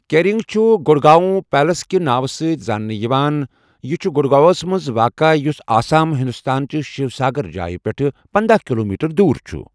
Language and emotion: Kashmiri, neutral